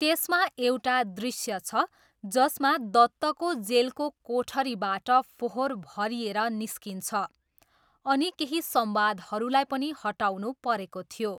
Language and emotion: Nepali, neutral